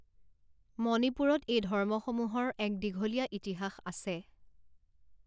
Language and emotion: Assamese, neutral